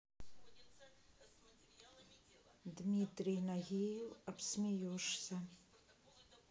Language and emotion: Russian, neutral